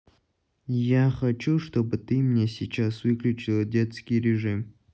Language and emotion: Russian, neutral